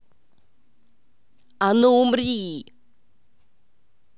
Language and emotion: Russian, angry